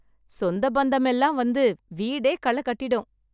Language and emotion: Tamil, happy